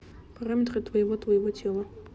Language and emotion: Russian, neutral